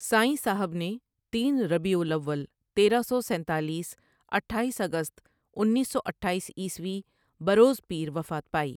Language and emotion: Urdu, neutral